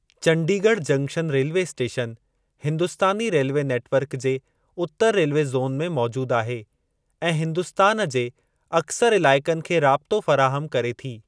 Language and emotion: Sindhi, neutral